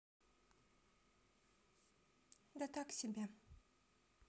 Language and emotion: Russian, sad